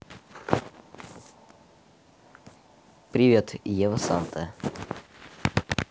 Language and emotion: Russian, neutral